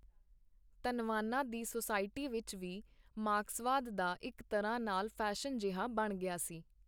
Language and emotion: Punjabi, neutral